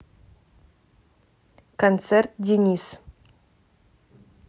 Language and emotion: Russian, neutral